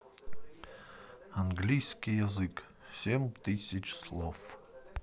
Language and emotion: Russian, neutral